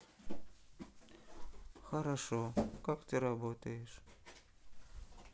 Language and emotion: Russian, sad